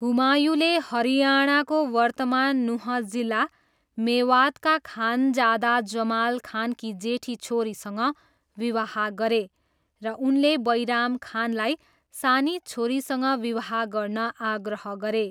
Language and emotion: Nepali, neutral